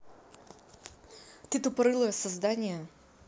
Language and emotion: Russian, angry